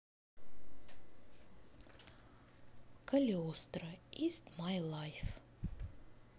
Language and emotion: Russian, neutral